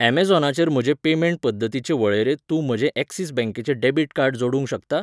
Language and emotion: Goan Konkani, neutral